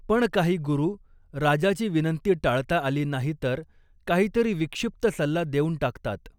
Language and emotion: Marathi, neutral